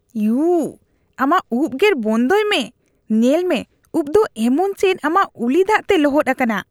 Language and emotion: Santali, disgusted